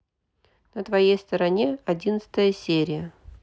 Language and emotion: Russian, neutral